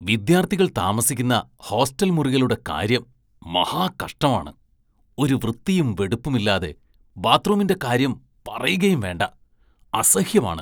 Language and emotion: Malayalam, disgusted